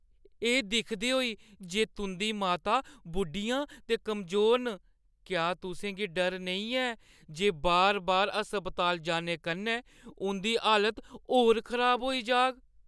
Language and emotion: Dogri, fearful